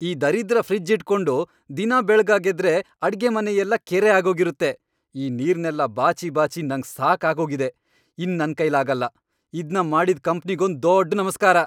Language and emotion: Kannada, angry